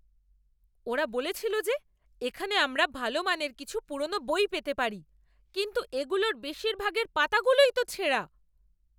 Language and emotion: Bengali, angry